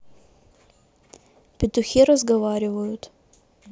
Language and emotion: Russian, neutral